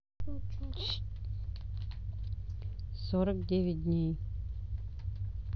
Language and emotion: Russian, neutral